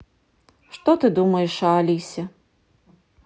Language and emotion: Russian, neutral